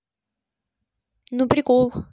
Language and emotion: Russian, neutral